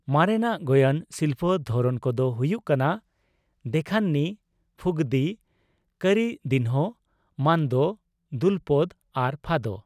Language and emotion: Santali, neutral